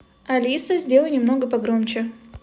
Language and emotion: Russian, neutral